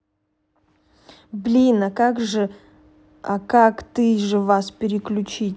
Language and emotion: Russian, neutral